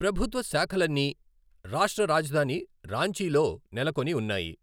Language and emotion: Telugu, neutral